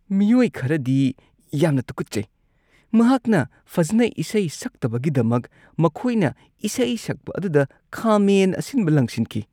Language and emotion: Manipuri, disgusted